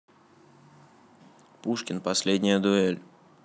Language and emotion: Russian, neutral